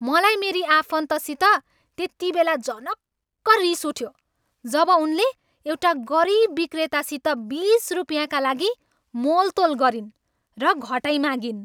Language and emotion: Nepali, angry